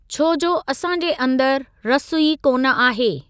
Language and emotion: Sindhi, neutral